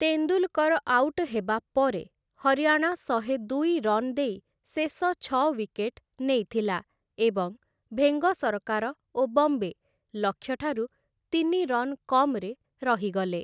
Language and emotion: Odia, neutral